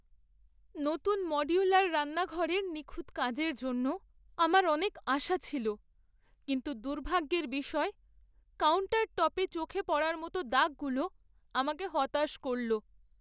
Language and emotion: Bengali, sad